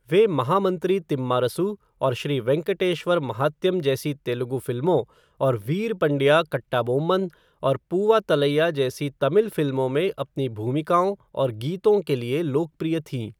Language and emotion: Hindi, neutral